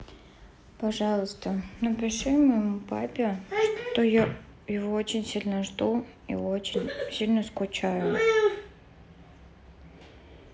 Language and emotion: Russian, sad